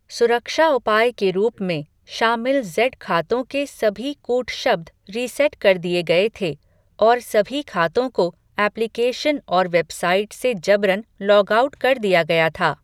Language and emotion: Hindi, neutral